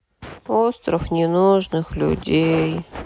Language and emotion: Russian, sad